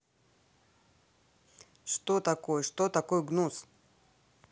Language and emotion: Russian, neutral